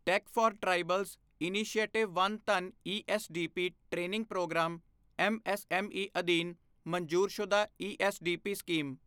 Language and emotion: Punjabi, neutral